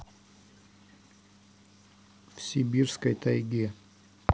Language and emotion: Russian, neutral